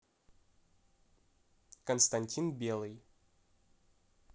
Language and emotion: Russian, neutral